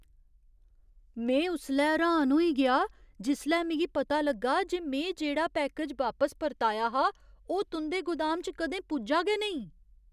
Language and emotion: Dogri, surprised